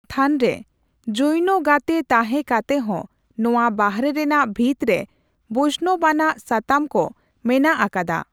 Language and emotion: Santali, neutral